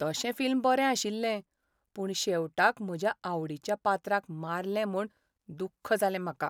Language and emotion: Goan Konkani, sad